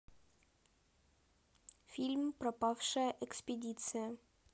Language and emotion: Russian, neutral